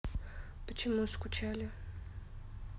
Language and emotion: Russian, neutral